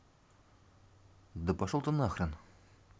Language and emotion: Russian, angry